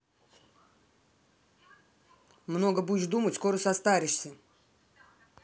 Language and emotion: Russian, angry